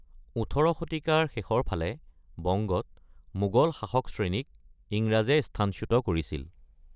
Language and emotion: Assamese, neutral